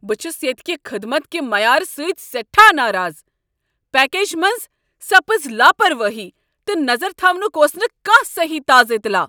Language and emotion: Kashmiri, angry